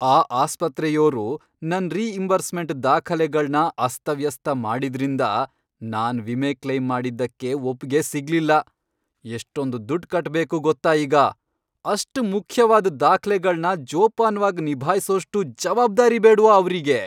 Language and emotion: Kannada, angry